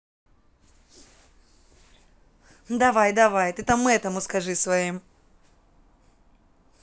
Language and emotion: Russian, angry